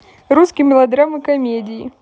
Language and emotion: Russian, positive